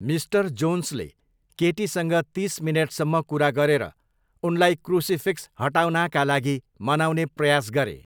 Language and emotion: Nepali, neutral